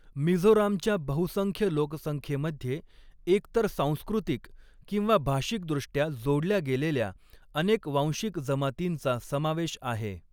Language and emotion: Marathi, neutral